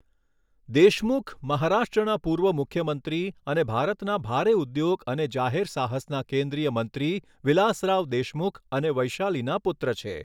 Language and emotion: Gujarati, neutral